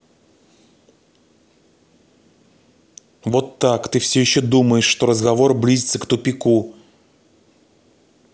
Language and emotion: Russian, angry